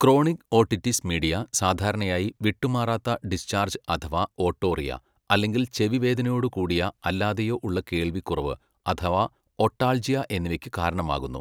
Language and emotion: Malayalam, neutral